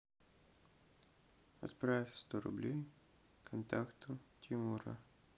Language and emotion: Russian, neutral